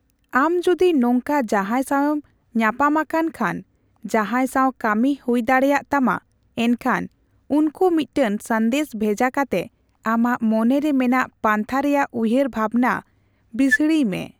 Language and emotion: Santali, neutral